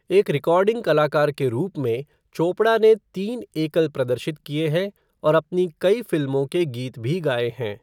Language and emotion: Hindi, neutral